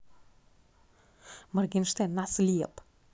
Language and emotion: Russian, angry